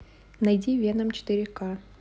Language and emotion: Russian, neutral